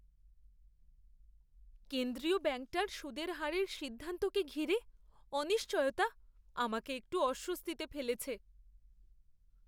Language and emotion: Bengali, fearful